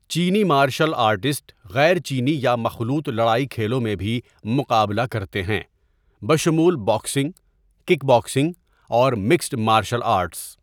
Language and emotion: Urdu, neutral